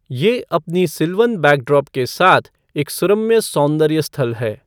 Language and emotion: Hindi, neutral